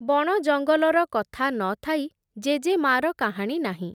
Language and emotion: Odia, neutral